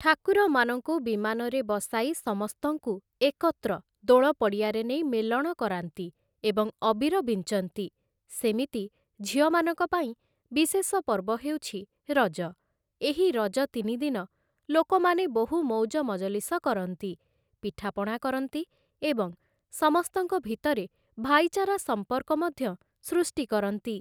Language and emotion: Odia, neutral